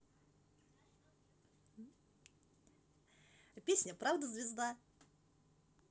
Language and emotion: Russian, positive